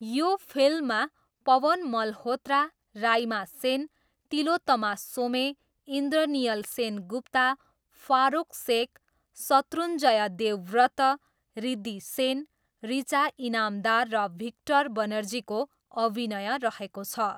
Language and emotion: Nepali, neutral